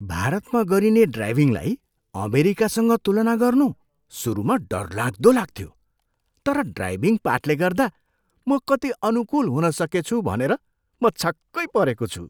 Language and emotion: Nepali, surprised